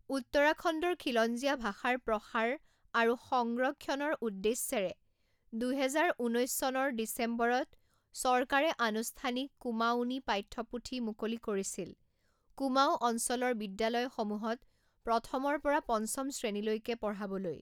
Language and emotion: Assamese, neutral